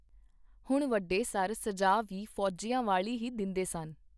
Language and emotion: Punjabi, neutral